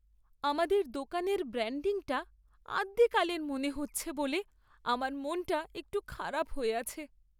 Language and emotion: Bengali, sad